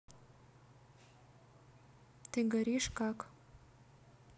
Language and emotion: Russian, neutral